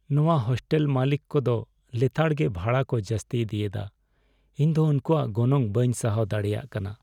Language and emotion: Santali, sad